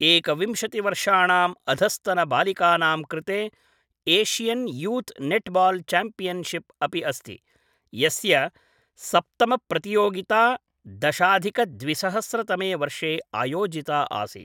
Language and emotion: Sanskrit, neutral